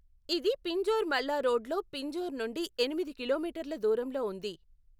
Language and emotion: Telugu, neutral